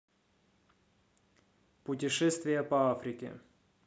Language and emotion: Russian, neutral